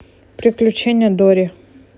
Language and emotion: Russian, neutral